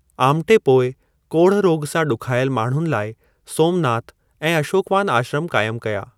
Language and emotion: Sindhi, neutral